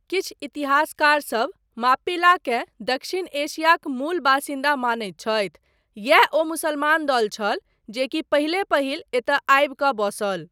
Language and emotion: Maithili, neutral